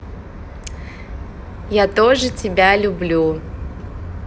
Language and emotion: Russian, positive